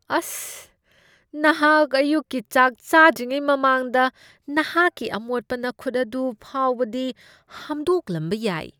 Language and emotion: Manipuri, disgusted